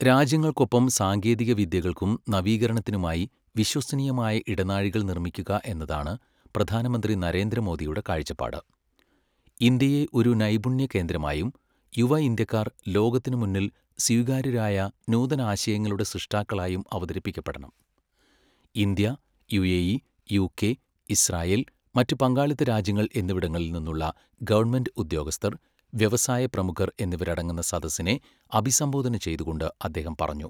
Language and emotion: Malayalam, neutral